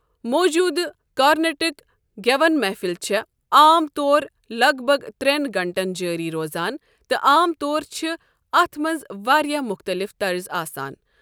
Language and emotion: Kashmiri, neutral